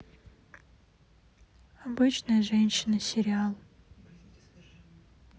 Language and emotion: Russian, neutral